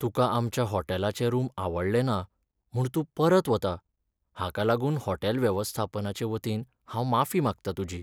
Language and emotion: Goan Konkani, sad